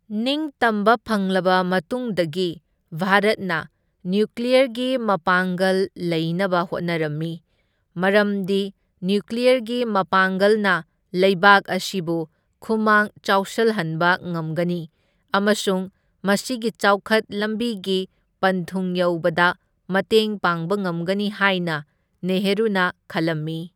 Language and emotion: Manipuri, neutral